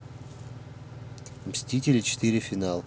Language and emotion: Russian, neutral